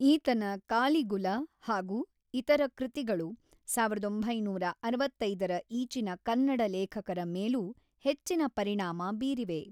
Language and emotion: Kannada, neutral